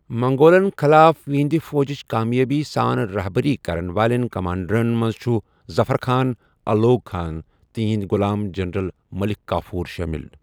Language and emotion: Kashmiri, neutral